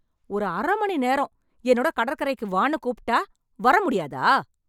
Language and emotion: Tamil, angry